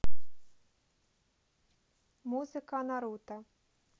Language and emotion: Russian, neutral